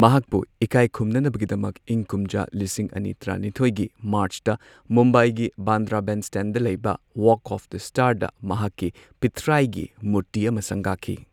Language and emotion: Manipuri, neutral